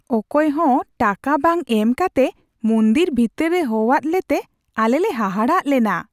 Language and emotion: Santali, surprised